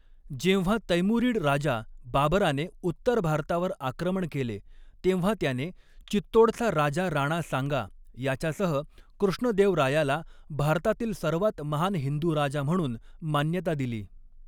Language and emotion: Marathi, neutral